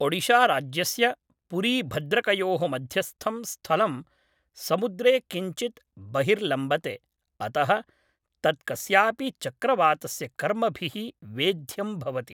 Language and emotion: Sanskrit, neutral